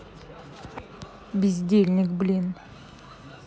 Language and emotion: Russian, angry